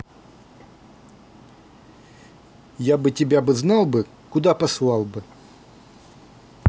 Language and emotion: Russian, angry